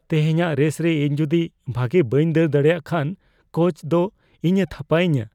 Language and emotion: Santali, fearful